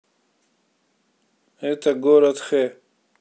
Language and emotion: Russian, neutral